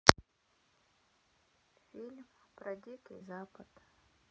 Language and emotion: Russian, sad